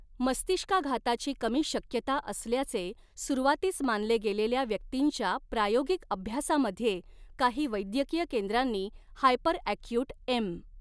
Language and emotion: Marathi, neutral